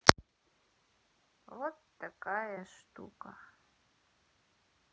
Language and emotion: Russian, sad